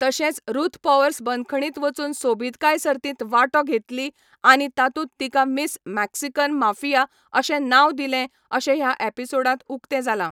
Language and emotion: Goan Konkani, neutral